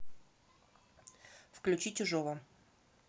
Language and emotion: Russian, neutral